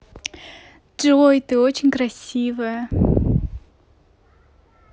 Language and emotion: Russian, positive